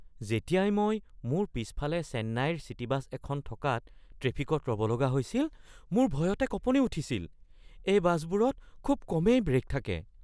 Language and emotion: Assamese, fearful